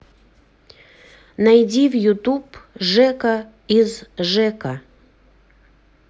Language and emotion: Russian, neutral